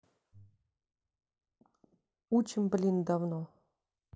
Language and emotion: Russian, neutral